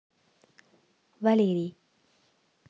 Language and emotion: Russian, neutral